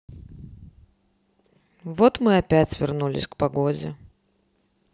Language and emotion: Russian, neutral